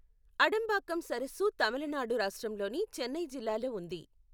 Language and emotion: Telugu, neutral